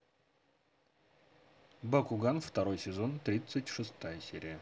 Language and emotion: Russian, positive